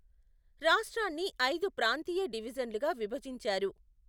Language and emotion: Telugu, neutral